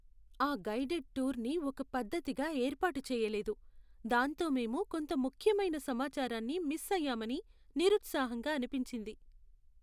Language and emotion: Telugu, sad